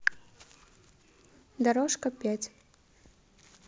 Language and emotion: Russian, neutral